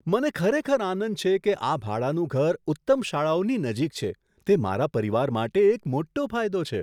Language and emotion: Gujarati, surprised